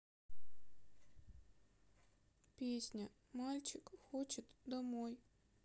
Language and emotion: Russian, sad